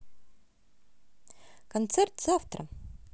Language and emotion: Russian, positive